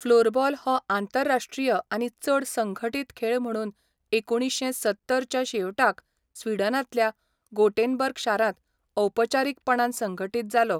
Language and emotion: Goan Konkani, neutral